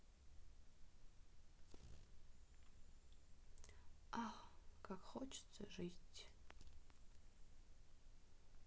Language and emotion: Russian, sad